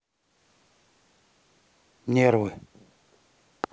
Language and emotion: Russian, neutral